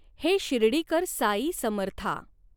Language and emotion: Marathi, neutral